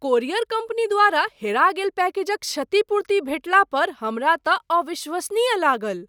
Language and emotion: Maithili, surprised